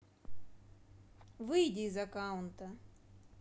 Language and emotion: Russian, neutral